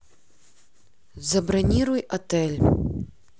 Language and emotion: Russian, neutral